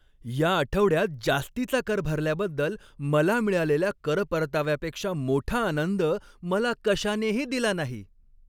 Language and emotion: Marathi, happy